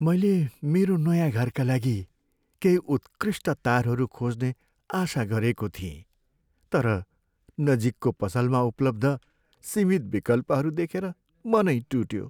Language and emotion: Nepali, sad